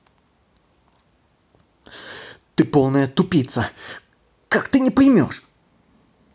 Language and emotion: Russian, angry